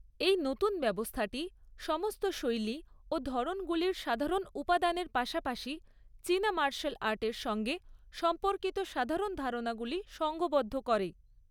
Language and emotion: Bengali, neutral